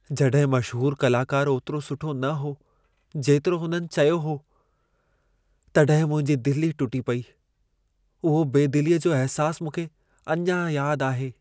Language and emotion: Sindhi, sad